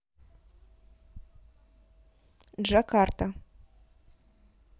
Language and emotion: Russian, neutral